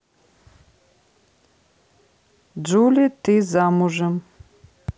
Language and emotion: Russian, neutral